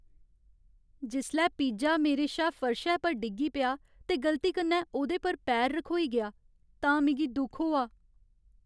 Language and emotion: Dogri, sad